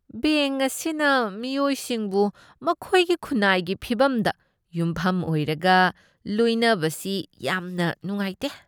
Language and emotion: Manipuri, disgusted